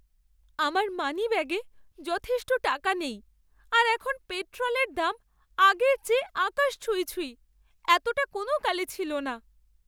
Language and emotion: Bengali, sad